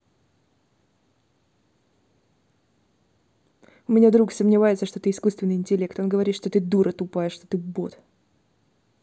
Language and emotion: Russian, angry